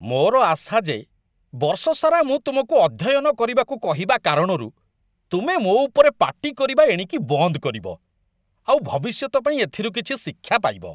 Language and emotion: Odia, disgusted